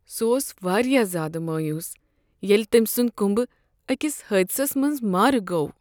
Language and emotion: Kashmiri, sad